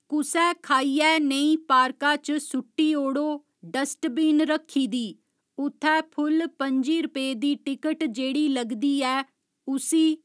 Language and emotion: Dogri, neutral